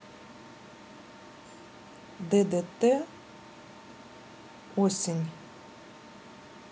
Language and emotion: Russian, neutral